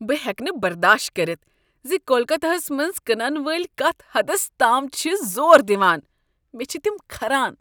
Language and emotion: Kashmiri, disgusted